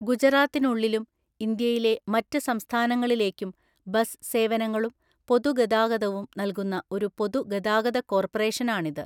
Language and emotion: Malayalam, neutral